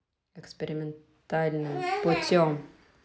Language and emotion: Russian, angry